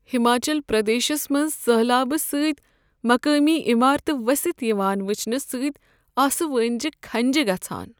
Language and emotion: Kashmiri, sad